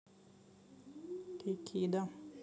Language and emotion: Russian, neutral